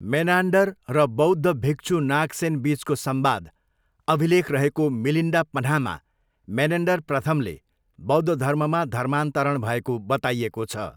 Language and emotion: Nepali, neutral